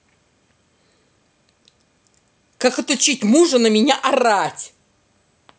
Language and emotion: Russian, angry